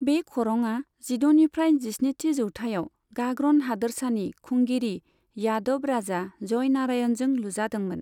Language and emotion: Bodo, neutral